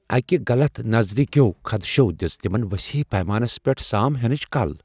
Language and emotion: Kashmiri, fearful